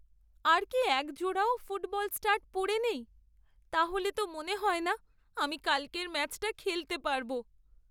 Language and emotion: Bengali, sad